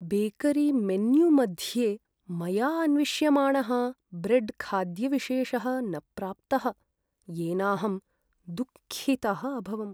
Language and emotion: Sanskrit, sad